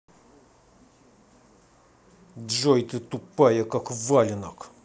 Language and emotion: Russian, angry